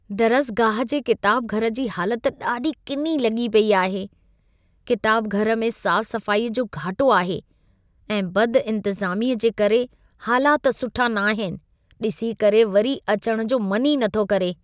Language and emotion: Sindhi, disgusted